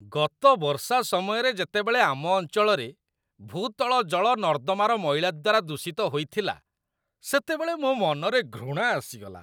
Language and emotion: Odia, disgusted